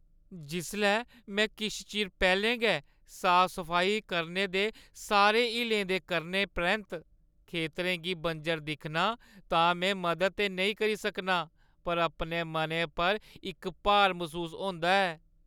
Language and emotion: Dogri, sad